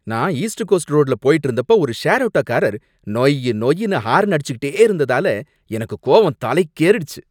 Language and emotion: Tamil, angry